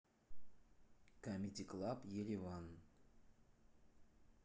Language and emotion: Russian, neutral